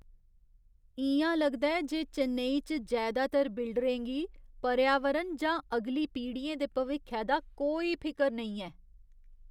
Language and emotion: Dogri, disgusted